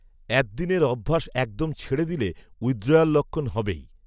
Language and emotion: Bengali, neutral